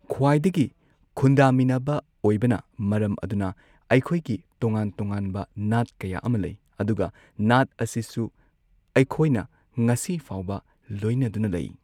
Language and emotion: Manipuri, neutral